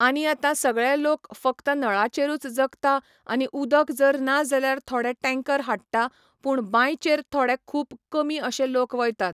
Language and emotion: Goan Konkani, neutral